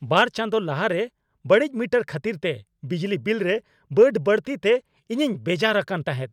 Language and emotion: Santali, angry